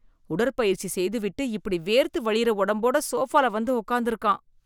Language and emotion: Tamil, disgusted